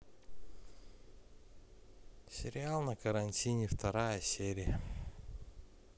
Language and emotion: Russian, sad